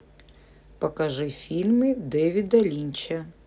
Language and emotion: Russian, neutral